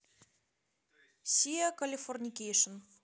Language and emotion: Russian, neutral